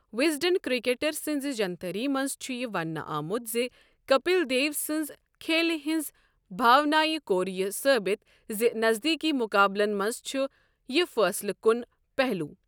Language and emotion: Kashmiri, neutral